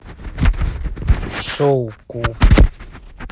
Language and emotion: Russian, neutral